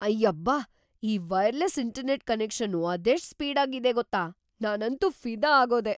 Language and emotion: Kannada, surprised